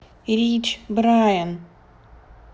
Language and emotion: Russian, neutral